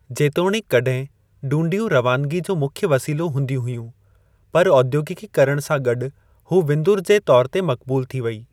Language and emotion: Sindhi, neutral